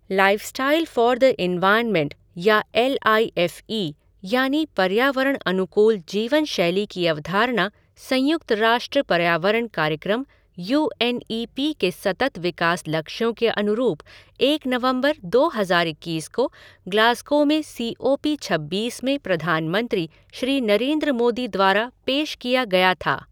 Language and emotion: Hindi, neutral